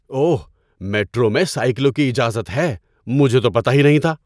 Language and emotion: Urdu, surprised